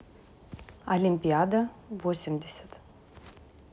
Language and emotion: Russian, neutral